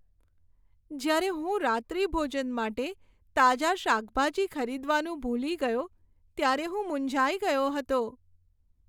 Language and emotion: Gujarati, sad